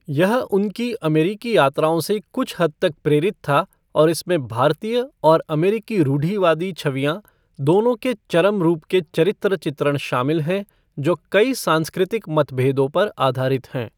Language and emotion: Hindi, neutral